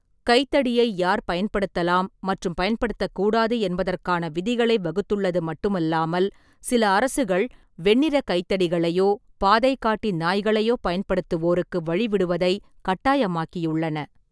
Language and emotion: Tamil, neutral